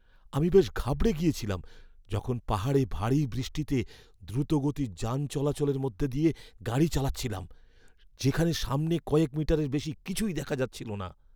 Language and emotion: Bengali, fearful